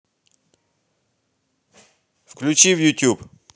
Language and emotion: Russian, neutral